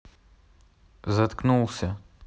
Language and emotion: Russian, angry